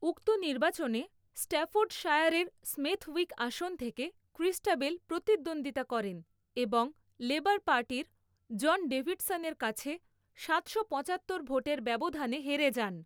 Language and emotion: Bengali, neutral